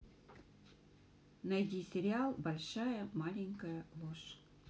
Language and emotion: Russian, neutral